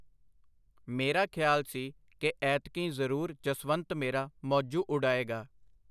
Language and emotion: Punjabi, neutral